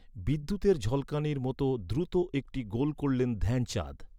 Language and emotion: Bengali, neutral